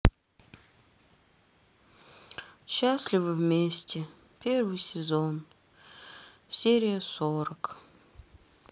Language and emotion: Russian, sad